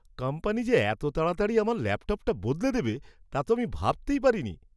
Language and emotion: Bengali, surprised